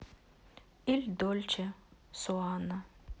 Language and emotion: Russian, sad